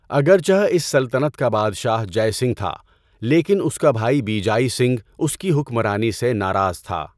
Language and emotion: Urdu, neutral